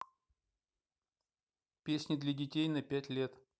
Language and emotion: Russian, neutral